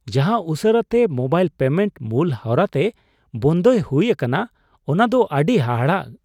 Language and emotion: Santali, surprised